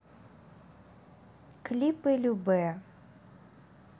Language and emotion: Russian, neutral